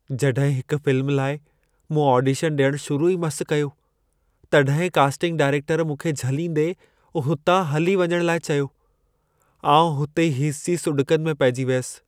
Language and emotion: Sindhi, sad